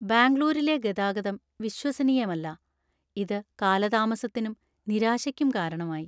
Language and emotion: Malayalam, sad